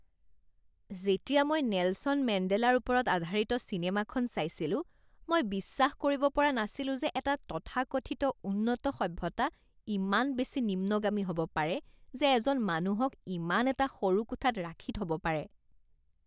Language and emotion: Assamese, disgusted